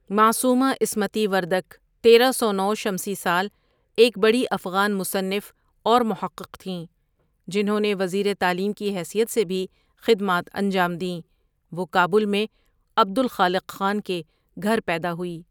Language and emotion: Urdu, neutral